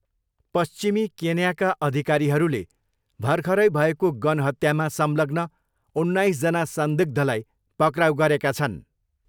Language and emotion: Nepali, neutral